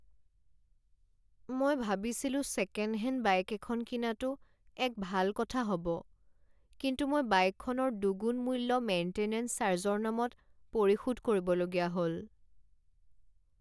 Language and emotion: Assamese, sad